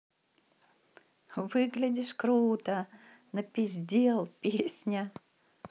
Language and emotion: Russian, positive